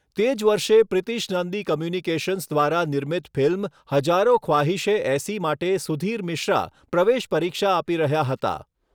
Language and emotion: Gujarati, neutral